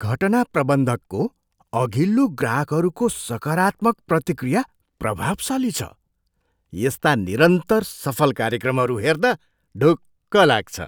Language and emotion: Nepali, surprised